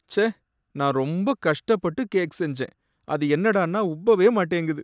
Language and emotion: Tamil, sad